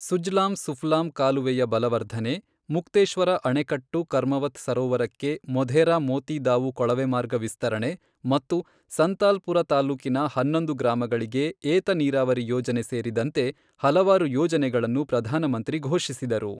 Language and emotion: Kannada, neutral